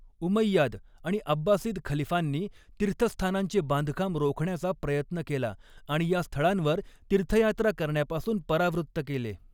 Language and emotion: Marathi, neutral